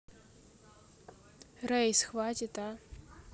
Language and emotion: Russian, neutral